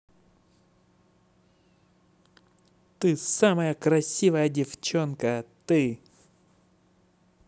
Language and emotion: Russian, positive